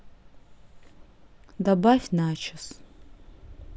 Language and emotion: Russian, neutral